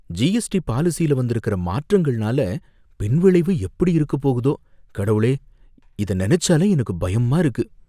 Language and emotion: Tamil, fearful